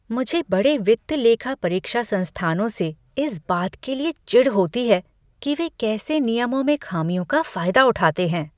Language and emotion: Hindi, disgusted